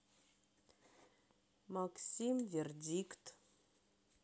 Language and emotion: Russian, neutral